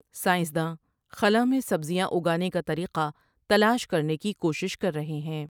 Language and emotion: Urdu, neutral